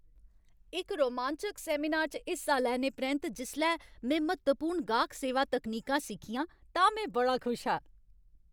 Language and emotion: Dogri, happy